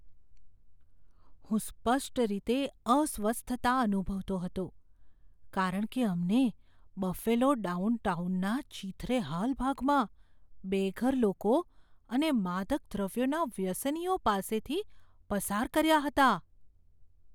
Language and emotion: Gujarati, fearful